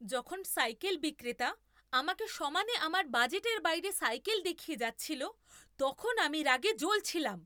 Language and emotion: Bengali, angry